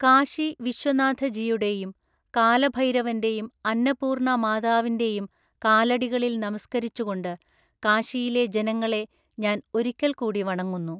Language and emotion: Malayalam, neutral